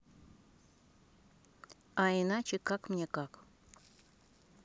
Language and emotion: Russian, neutral